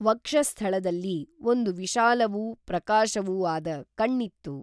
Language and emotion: Kannada, neutral